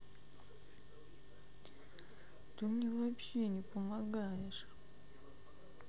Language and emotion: Russian, sad